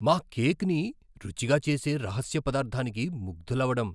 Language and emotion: Telugu, surprised